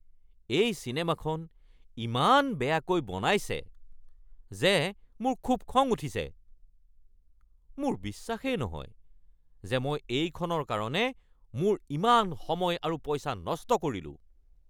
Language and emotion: Assamese, angry